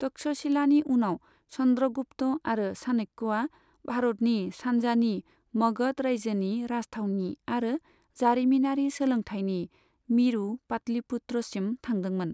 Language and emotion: Bodo, neutral